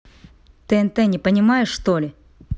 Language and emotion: Russian, angry